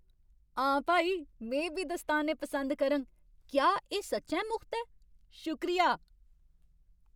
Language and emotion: Dogri, happy